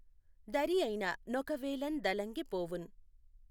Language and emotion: Telugu, neutral